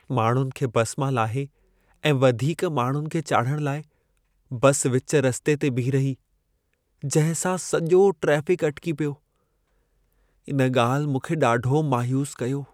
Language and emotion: Sindhi, sad